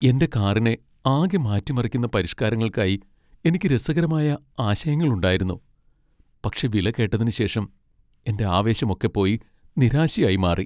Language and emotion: Malayalam, sad